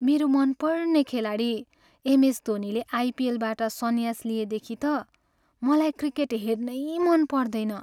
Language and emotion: Nepali, sad